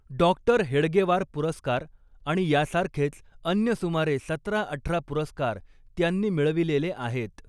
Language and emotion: Marathi, neutral